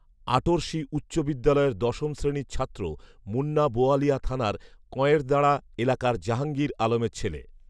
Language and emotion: Bengali, neutral